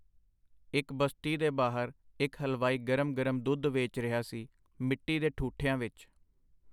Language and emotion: Punjabi, neutral